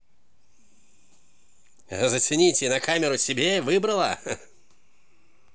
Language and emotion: Russian, positive